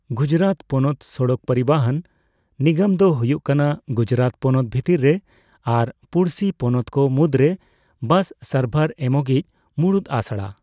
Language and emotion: Santali, neutral